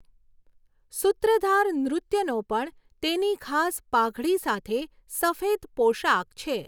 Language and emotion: Gujarati, neutral